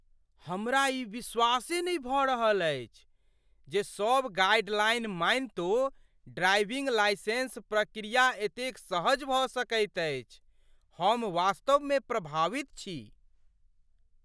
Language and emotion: Maithili, surprised